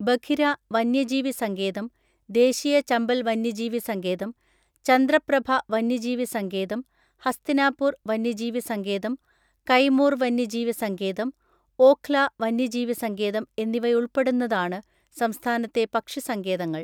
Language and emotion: Malayalam, neutral